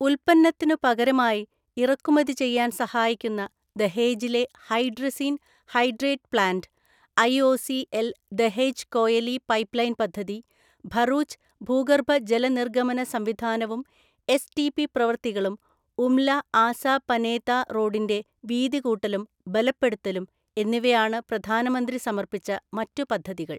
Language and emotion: Malayalam, neutral